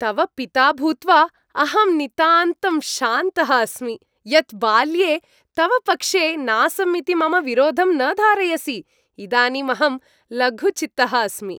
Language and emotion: Sanskrit, happy